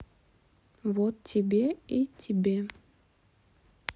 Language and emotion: Russian, neutral